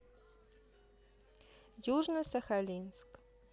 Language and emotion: Russian, neutral